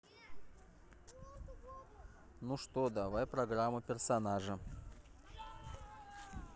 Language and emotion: Russian, neutral